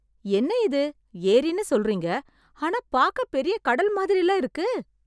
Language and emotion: Tamil, surprised